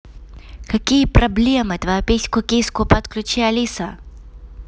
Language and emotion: Russian, angry